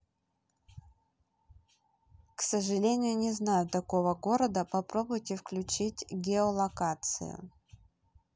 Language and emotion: Russian, neutral